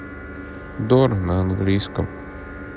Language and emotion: Russian, sad